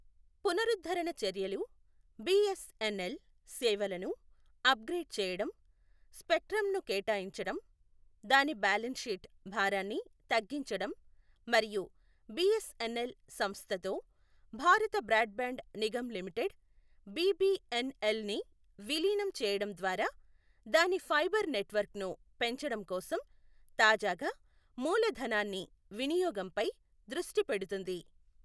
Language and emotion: Telugu, neutral